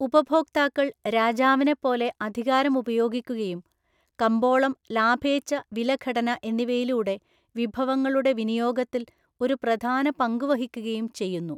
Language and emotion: Malayalam, neutral